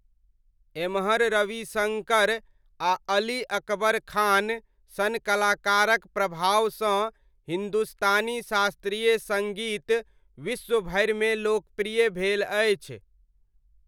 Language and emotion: Maithili, neutral